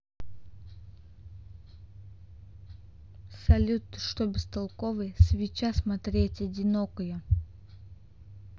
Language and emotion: Russian, neutral